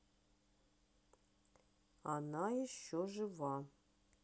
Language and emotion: Russian, neutral